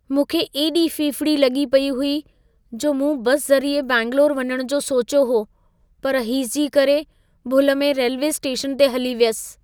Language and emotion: Sindhi, fearful